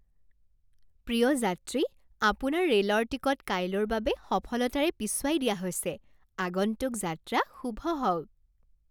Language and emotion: Assamese, happy